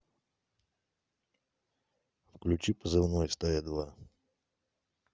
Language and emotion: Russian, neutral